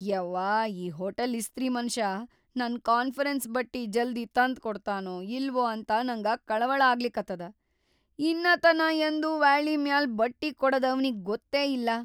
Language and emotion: Kannada, fearful